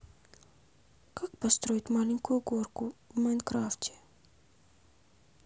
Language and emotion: Russian, sad